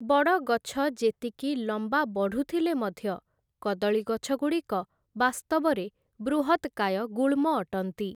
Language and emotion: Odia, neutral